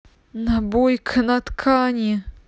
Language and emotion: Russian, positive